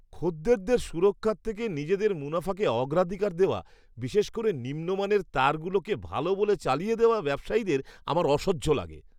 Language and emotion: Bengali, disgusted